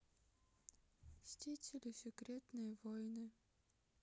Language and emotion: Russian, sad